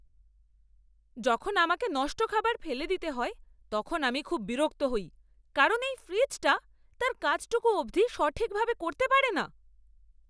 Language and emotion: Bengali, angry